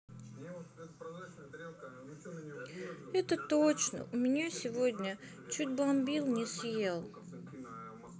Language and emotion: Russian, sad